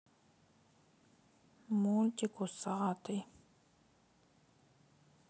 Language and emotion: Russian, sad